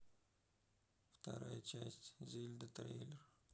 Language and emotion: Russian, sad